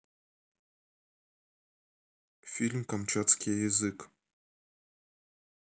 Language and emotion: Russian, neutral